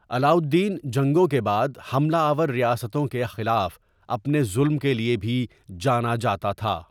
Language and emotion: Urdu, neutral